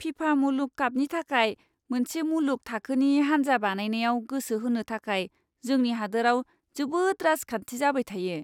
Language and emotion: Bodo, disgusted